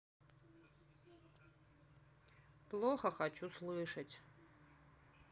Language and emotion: Russian, sad